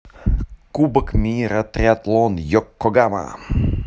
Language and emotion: Russian, neutral